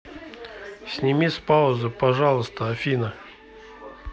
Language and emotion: Russian, neutral